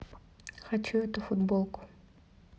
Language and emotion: Russian, neutral